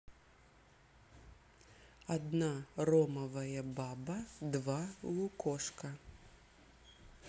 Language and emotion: Russian, neutral